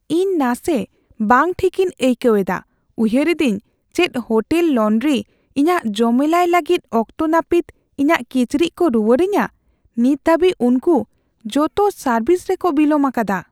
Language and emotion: Santali, fearful